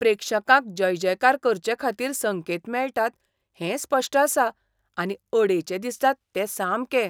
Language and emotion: Goan Konkani, disgusted